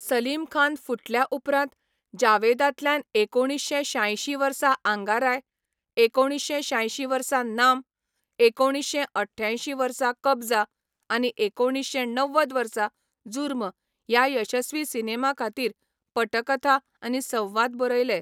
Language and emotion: Goan Konkani, neutral